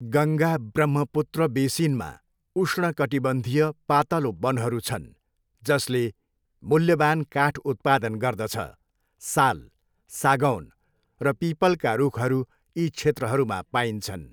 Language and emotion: Nepali, neutral